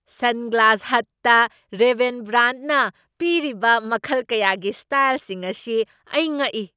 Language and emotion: Manipuri, surprised